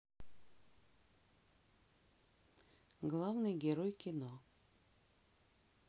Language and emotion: Russian, neutral